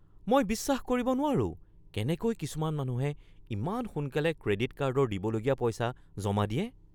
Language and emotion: Assamese, surprised